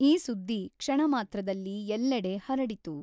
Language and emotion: Kannada, neutral